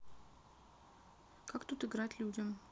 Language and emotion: Russian, neutral